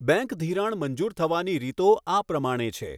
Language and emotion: Gujarati, neutral